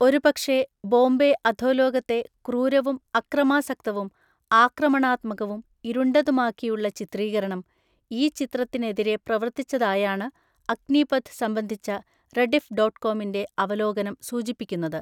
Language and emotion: Malayalam, neutral